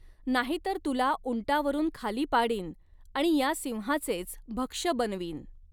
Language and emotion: Marathi, neutral